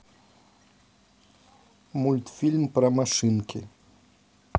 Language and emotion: Russian, neutral